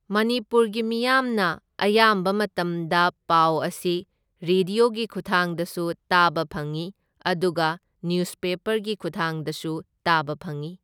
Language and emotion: Manipuri, neutral